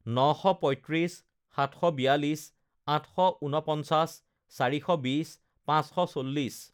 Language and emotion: Assamese, neutral